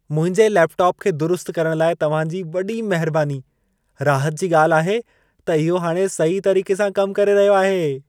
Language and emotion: Sindhi, happy